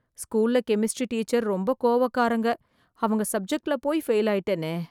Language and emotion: Tamil, fearful